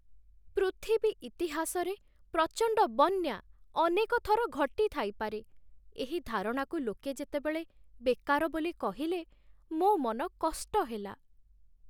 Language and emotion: Odia, sad